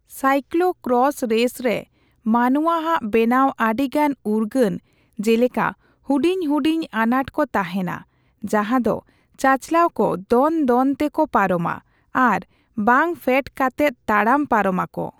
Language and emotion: Santali, neutral